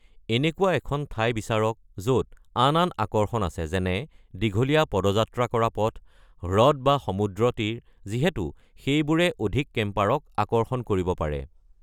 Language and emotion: Assamese, neutral